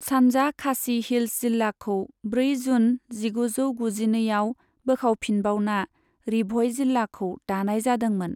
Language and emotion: Bodo, neutral